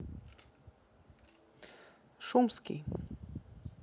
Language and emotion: Russian, neutral